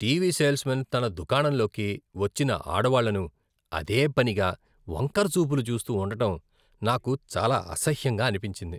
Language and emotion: Telugu, disgusted